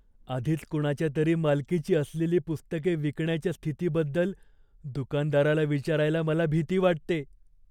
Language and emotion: Marathi, fearful